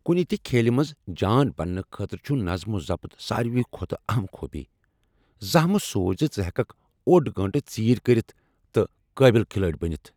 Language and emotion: Kashmiri, angry